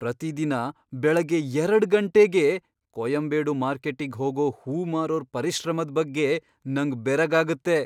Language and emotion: Kannada, surprised